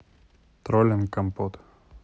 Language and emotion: Russian, neutral